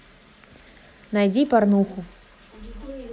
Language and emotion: Russian, neutral